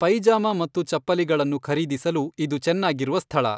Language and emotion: Kannada, neutral